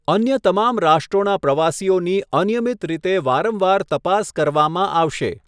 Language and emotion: Gujarati, neutral